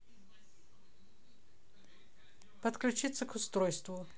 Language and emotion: Russian, neutral